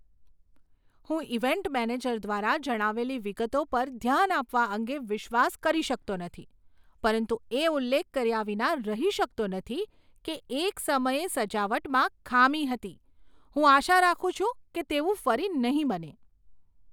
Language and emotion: Gujarati, surprised